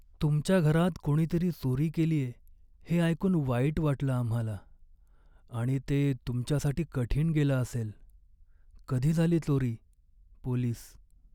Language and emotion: Marathi, sad